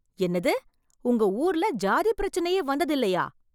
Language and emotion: Tamil, surprised